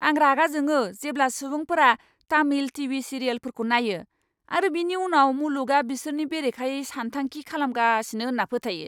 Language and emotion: Bodo, angry